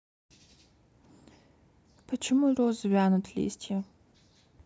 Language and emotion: Russian, neutral